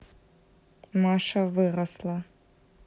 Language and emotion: Russian, neutral